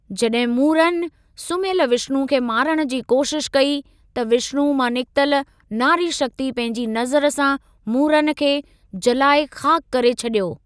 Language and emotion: Sindhi, neutral